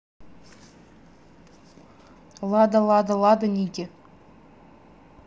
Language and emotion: Russian, neutral